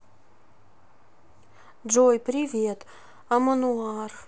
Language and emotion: Russian, sad